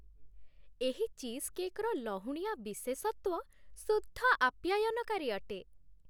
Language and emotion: Odia, happy